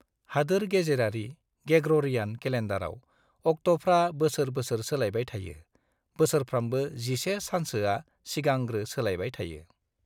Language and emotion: Bodo, neutral